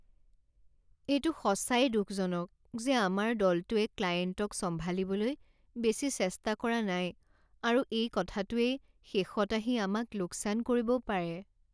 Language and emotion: Assamese, sad